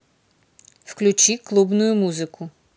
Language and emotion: Russian, neutral